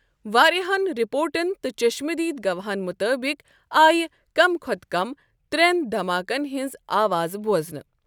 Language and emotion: Kashmiri, neutral